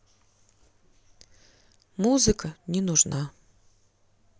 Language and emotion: Russian, sad